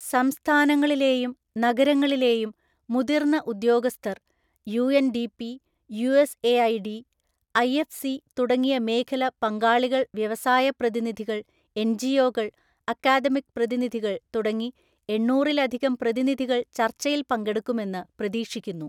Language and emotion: Malayalam, neutral